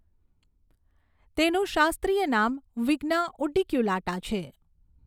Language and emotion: Gujarati, neutral